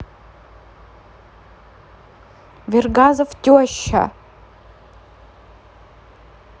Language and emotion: Russian, neutral